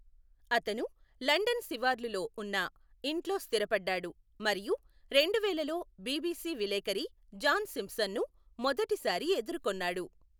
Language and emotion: Telugu, neutral